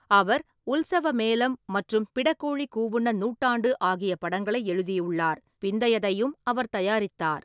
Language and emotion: Tamil, neutral